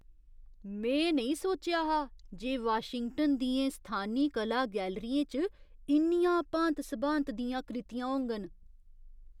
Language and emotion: Dogri, surprised